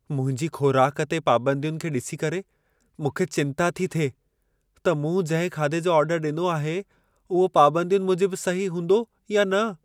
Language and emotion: Sindhi, fearful